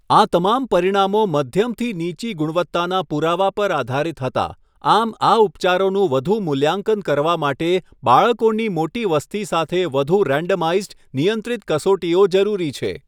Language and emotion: Gujarati, neutral